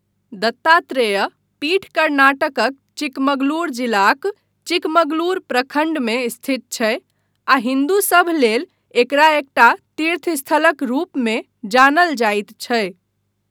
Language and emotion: Maithili, neutral